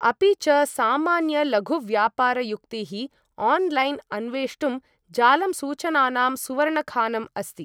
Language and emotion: Sanskrit, neutral